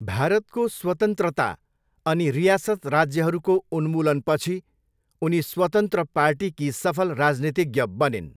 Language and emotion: Nepali, neutral